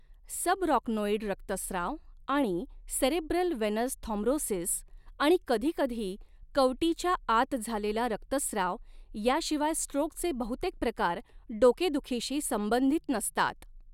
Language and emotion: Marathi, neutral